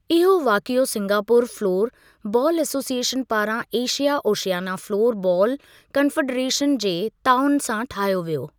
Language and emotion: Sindhi, neutral